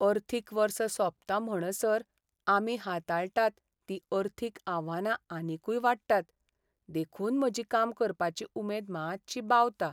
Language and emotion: Goan Konkani, sad